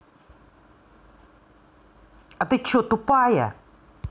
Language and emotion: Russian, angry